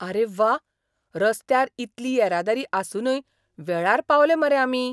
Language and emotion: Goan Konkani, surprised